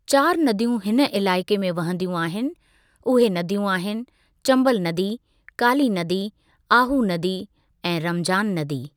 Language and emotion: Sindhi, neutral